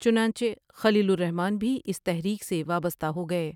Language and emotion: Urdu, neutral